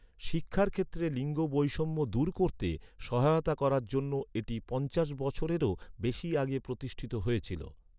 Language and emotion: Bengali, neutral